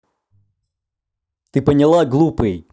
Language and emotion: Russian, angry